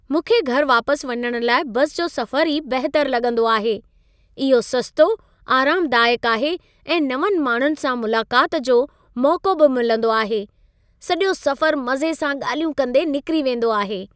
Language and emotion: Sindhi, happy